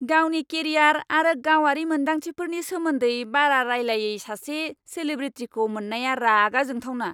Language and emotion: Bodo, angry